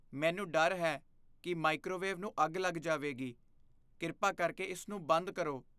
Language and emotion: Punjabi, fearful